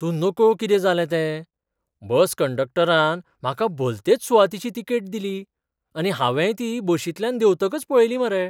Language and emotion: Goan Konkani, surprised